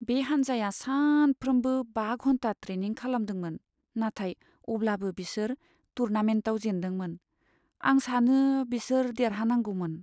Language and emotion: Bodo, sad